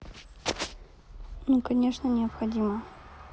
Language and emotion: Russian, neutral